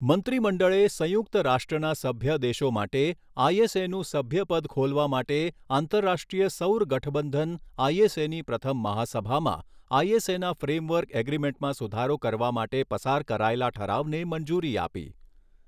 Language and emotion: Gujarati, neutral